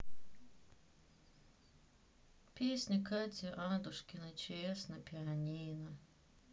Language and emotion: Russian, sad